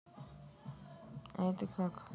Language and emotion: Russian, sad